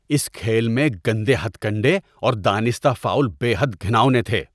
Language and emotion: Urdu, disgusted